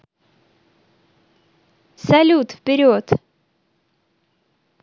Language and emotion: Russian, positive